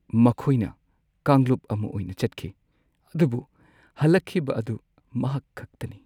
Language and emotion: Manipuri, sad